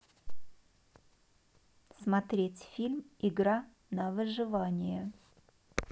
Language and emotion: Russian, neutral